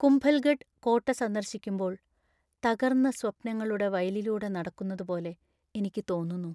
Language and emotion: Malayalam, sad